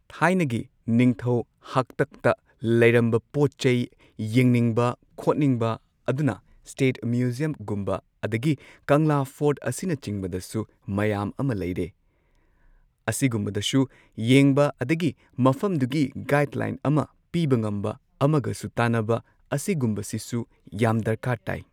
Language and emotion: Manipuri, neutral